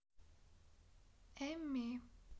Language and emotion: Russian, sad